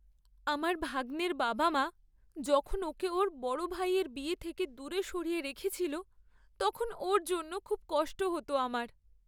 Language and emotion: Bengali, sad